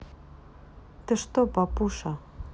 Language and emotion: Russian, neutral